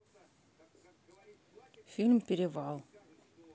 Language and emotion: Russian, neutral